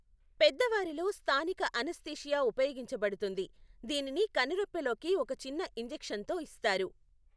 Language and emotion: Telugu, neutral